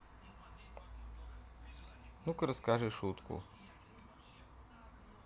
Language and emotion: Russian, neutral